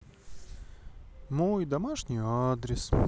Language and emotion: Russian, neutral